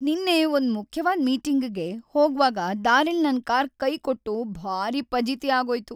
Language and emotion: Kannada, sad